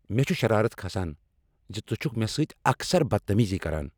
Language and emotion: Kashmiri, angry